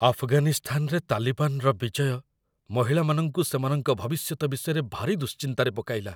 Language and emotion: Odia, fearful